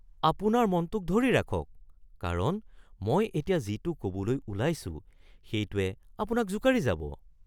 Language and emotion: Assamese, surprised